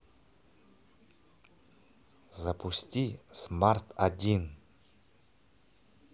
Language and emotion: Russian, neutral